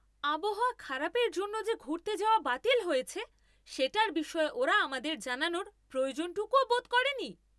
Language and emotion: Bengali, angry